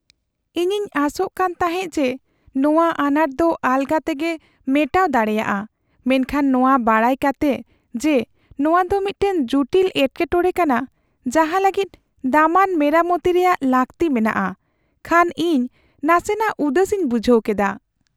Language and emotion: Santali, sad